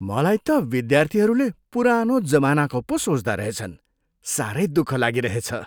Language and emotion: Nepali, disgusted